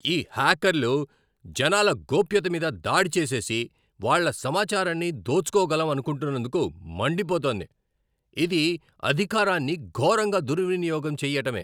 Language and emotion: Telugu, angry